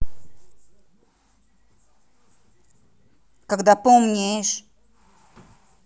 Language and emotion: Russian, angry